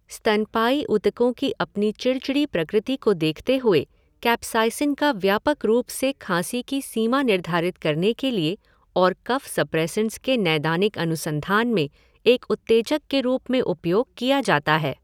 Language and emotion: Hindi, neutral